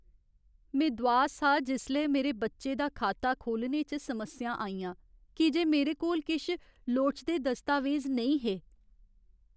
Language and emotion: Dogri, sad